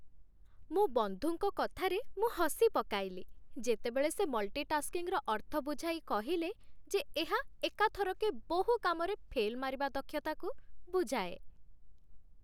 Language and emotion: Odia, happy